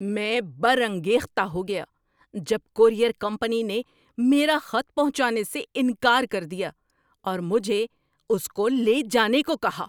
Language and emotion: Urdu, angry